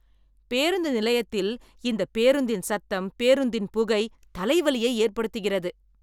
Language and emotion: Tamil, angry